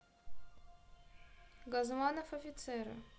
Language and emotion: Russian, neutral